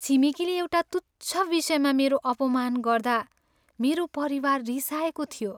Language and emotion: Nepali, sad